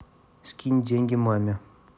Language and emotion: Russian, neutral